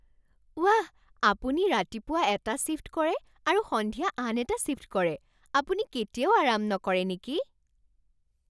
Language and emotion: Assamese, surprised